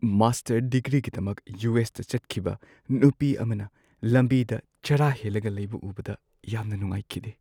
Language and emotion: Manipuri, sad